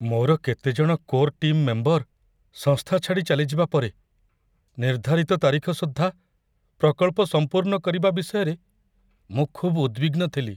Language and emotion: Odia, fearful